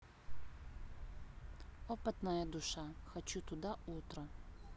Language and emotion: Russian, neutral